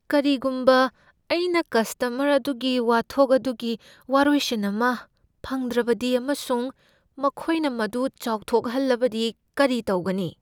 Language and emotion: Manipuri, fearful